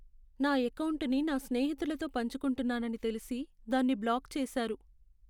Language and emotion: Telugu, sad